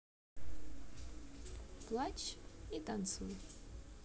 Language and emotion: Russian, neutral